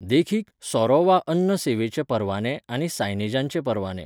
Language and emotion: Goan Konkani, neutral